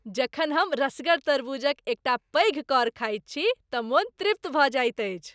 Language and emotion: Maithili, happy